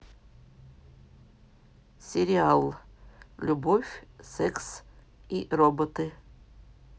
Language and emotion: Russian, neutral